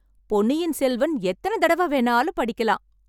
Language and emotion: Tamil, happy